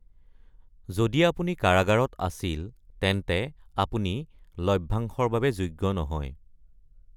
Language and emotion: Assamese, neutral